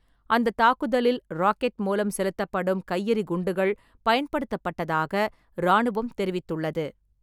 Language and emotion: Tamil, neutral